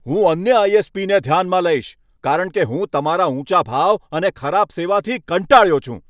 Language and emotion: Gujarati, angry